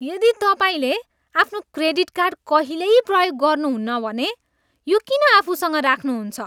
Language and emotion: Nepali, disgusted